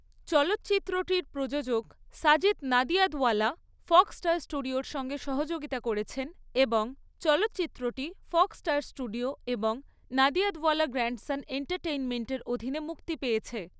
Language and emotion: Bengali, neutral